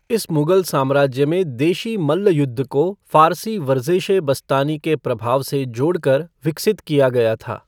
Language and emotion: Hindi, neutral